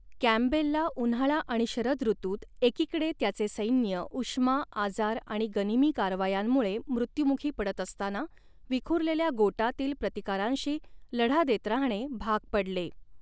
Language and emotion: Marathi, neutral